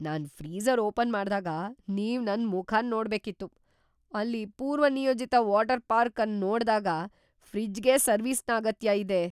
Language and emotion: Kannada, surprised